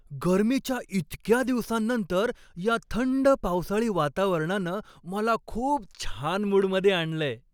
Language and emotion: Marathi, happy